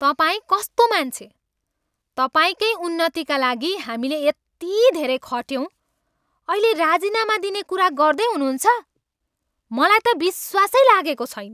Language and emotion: Nepali, angry